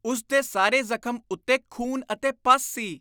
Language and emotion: Punjabi, disgusted